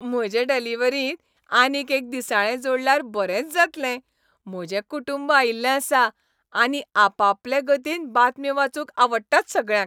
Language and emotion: Goan Konkani, happy